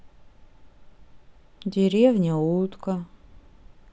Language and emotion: Russian, sad